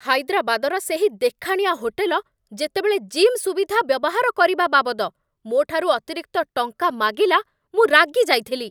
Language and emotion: Odia, angry